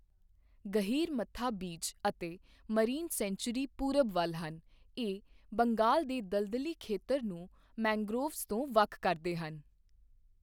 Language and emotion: Punjabi, neutral